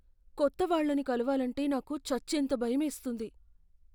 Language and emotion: Telugu, fearful